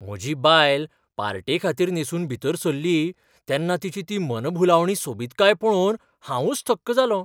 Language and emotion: Goan Konkani, surprised